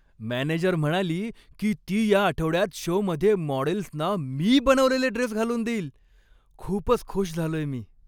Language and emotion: Marathi, happy